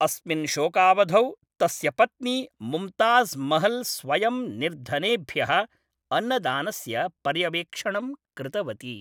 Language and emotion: Sanskrit, neutral